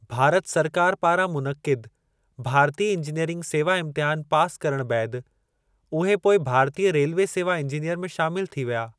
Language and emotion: Sindhi, neutral